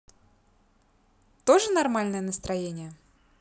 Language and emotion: Russian, positive